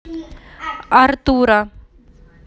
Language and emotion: Russian, neutral